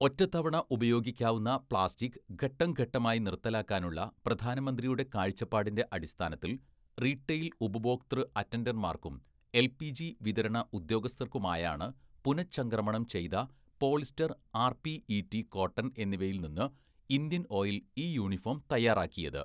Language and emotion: Malayalam, neutral